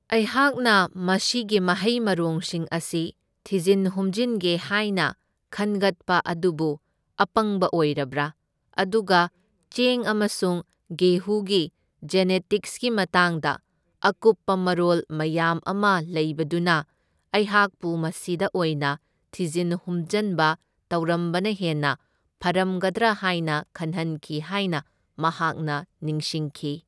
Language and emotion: Manipuri, neutral